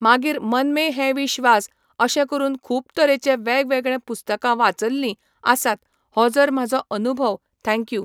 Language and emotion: Goan Konkani, neutral